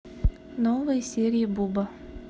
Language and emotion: Russian, neutral